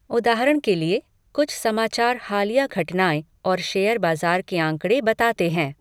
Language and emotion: Hindi, neutral